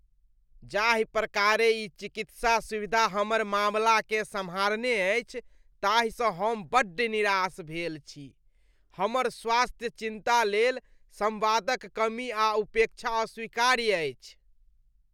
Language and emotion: Maithili, disgusted